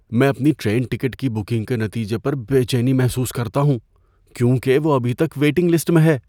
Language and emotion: Urdu, fearful